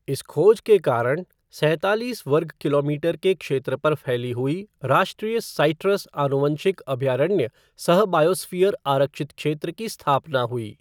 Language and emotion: Hindi, neutral